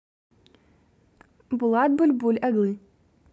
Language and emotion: Russian, neutral